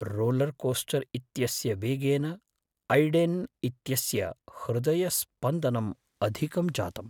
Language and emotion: Sanskrit, fearful